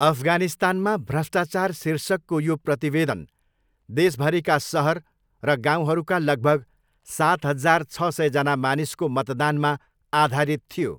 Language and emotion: Nepali, neutral